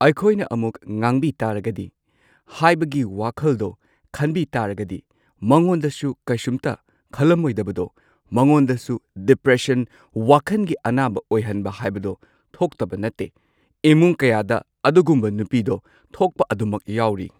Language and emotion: Manipuri, neutral